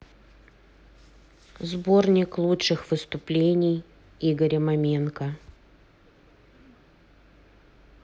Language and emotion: Russian, neutral